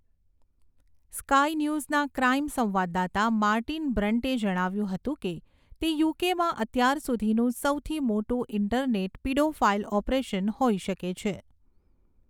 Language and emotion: Gujarati, neutral